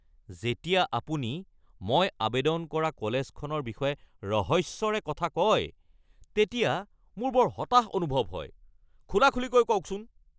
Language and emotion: Assamese, angry